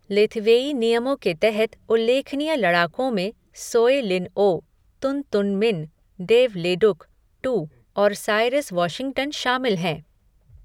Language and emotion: Hindi, neutral